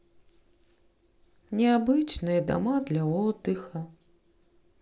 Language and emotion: Russian, sad